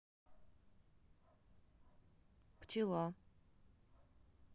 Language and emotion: Russian, neutral